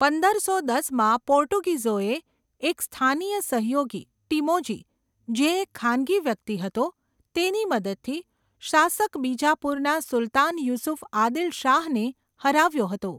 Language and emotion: Gujarati, neutral